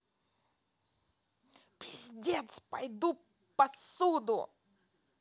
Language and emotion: Russian, angry